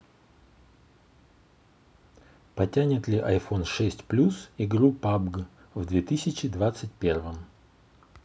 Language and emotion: Russian, neutral